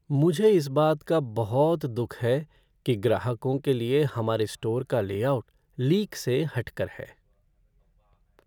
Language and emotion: Hindi, sad